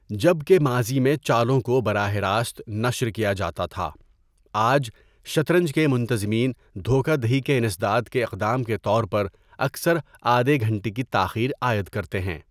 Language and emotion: Urdu, neutral